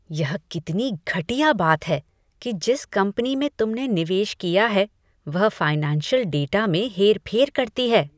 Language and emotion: Hindi, disgusted